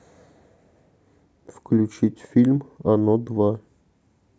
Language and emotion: Russian, neutral